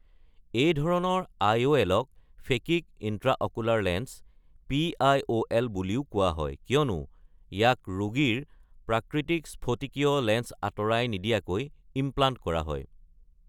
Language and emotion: Assamese, neutral